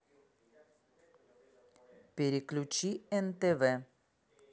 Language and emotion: Russian, neutral